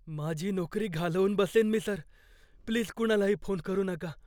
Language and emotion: Marathi, fearful